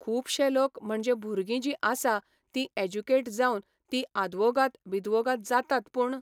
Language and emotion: Goan Konkani, neutral